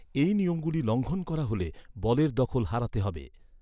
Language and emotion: Bengali, neutral